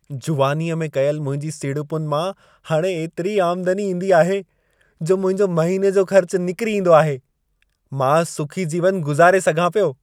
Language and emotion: Sindhi, happy